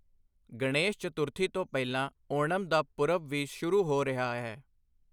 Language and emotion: Punjabi, neutral